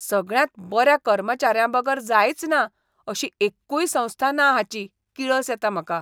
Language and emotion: Goan Konkani, disgusted